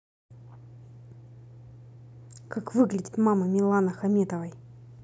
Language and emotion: Russian, angry